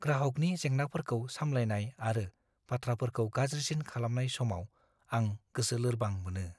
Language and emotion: Bodo, fearful